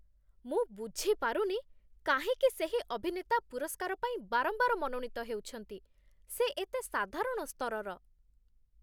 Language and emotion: Odia, disgusted